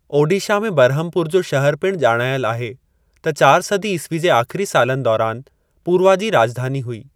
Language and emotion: Sindhi, neutral